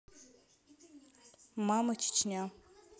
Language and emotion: Russian, neutral